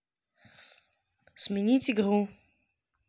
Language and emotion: Russian, neutral